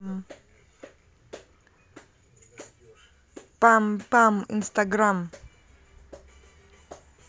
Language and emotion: Russian, positive